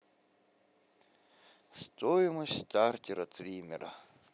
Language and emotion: Russian, neutral